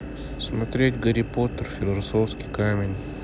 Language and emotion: Russian, neutral